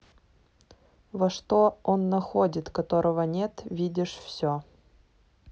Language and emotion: Russian, neutral